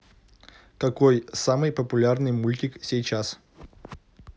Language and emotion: Russian, neutral